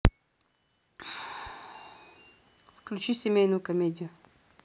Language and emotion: Russian, neutral